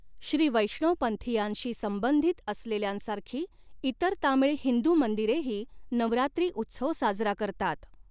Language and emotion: Marathi, neutral